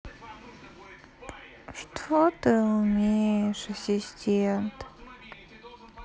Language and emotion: Russian, sad